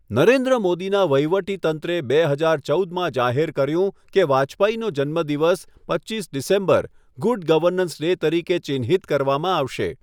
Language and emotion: Gujarati, neutral